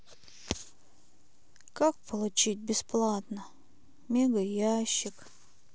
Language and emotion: Russian, sad